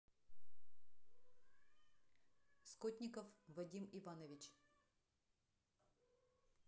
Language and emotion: Russian, neutral